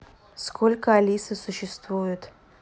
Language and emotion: Russian, neutral